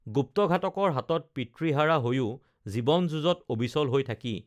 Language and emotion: Assamese, neutral